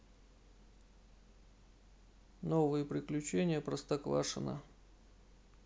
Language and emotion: Russian, neutral